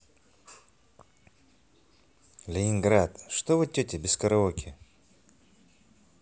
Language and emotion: Russian, neutral